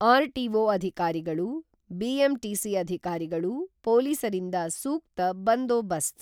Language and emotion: Kannada, neutral